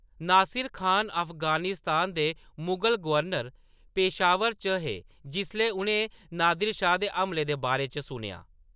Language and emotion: Dogri, neutral